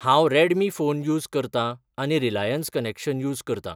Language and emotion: Goan Konkani, neutral